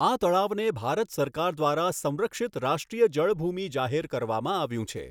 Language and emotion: Gujarati, neutral